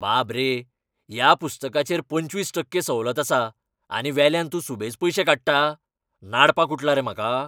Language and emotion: Goan Konkani, angry